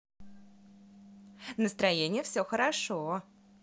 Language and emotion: Russian, positive